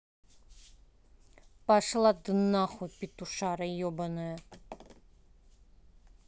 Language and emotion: Russian, angry